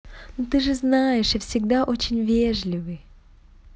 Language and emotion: Russian, positive